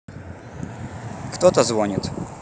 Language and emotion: Russian, neutral